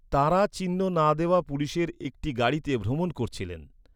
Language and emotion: Bengali, neutral